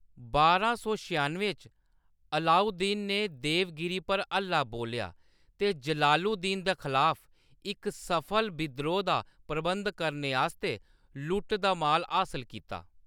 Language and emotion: Dogri, neutral